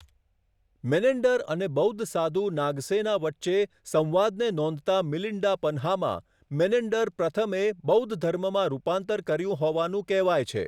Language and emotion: Gujarati, neutral